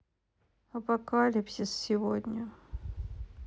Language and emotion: Russian, sad